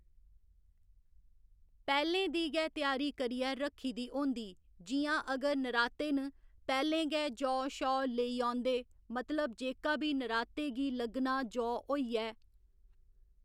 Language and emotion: Dogri, neutral